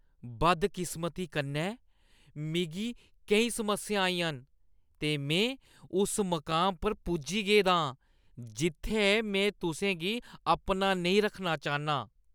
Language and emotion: Dogri, disgusted